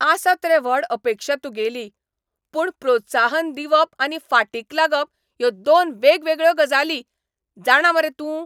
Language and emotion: Goan Konkani, angry